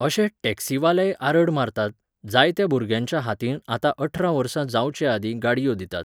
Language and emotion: Goan Konkani, neutral